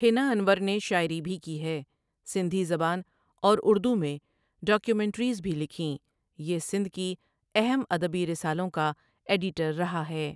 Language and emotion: Urdu, neutral